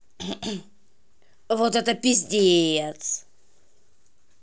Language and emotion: Russian, angry